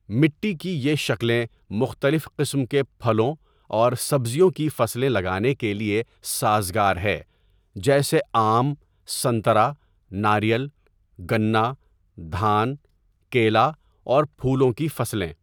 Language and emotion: Urdu, neutral